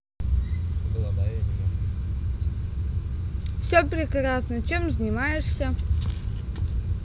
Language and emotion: Russian, positive